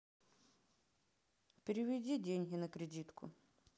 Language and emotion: Russian, sad